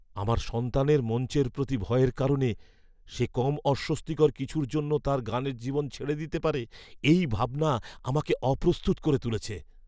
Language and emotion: Bengali, fearful